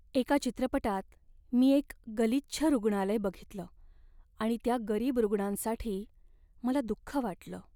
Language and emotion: Marathi, sad